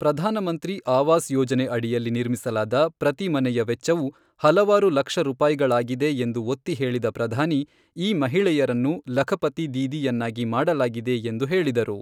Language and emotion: Kannada, neutral